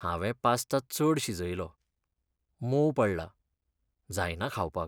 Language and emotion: Goan Konkani, sad